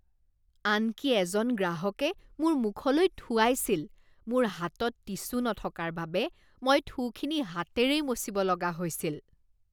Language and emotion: Assamese, disgusted